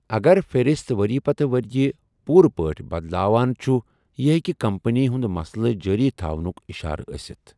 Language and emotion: Kashmiri, neutral